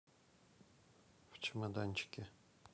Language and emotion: Russian, neutral